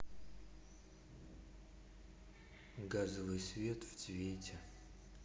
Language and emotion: Russian, neutral